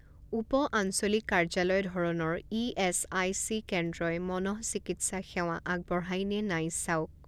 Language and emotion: Assamese, neutral